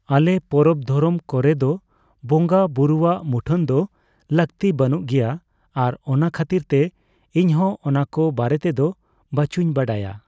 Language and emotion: Santali, neutral